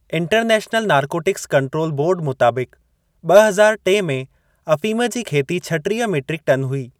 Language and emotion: Sindhi, neutral